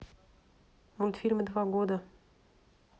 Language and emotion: Russian, neutral